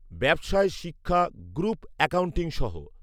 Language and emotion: Bengali, neutral